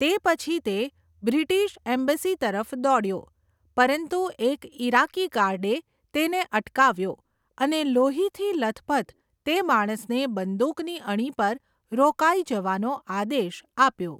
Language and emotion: Gujarati, neutral